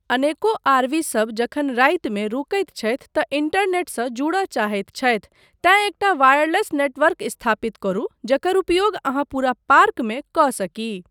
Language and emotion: Maithili, neutral